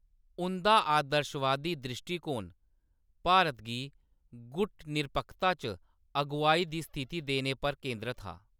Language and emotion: Dogri, neutral